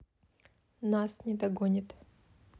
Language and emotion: Russian, neutral